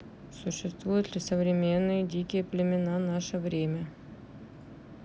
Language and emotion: Russian, neutral